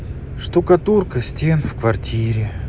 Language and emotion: Russian, sad